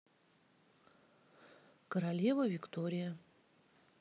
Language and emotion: Russian, neutral